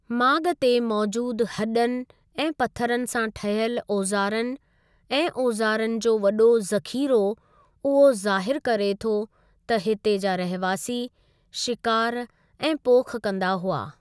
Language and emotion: Sindhi, neutral